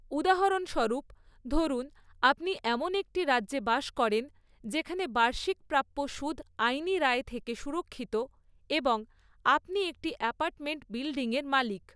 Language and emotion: Bengali, neutral